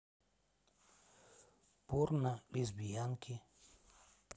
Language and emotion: Russian, neutral